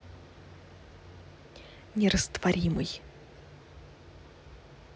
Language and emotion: Russian, neutral